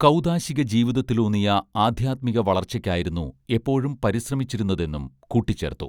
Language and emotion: Malayalam, neutral